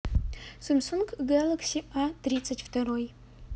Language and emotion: Russian, neutral